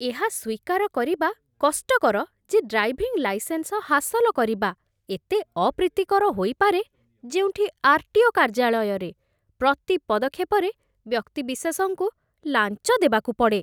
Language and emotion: Odia, disgusted